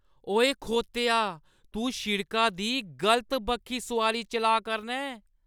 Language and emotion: Dogri, angry